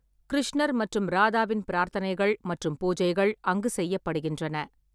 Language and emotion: Tamil, neutral